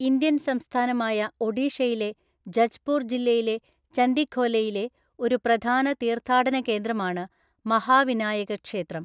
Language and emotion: Malayalam, neutral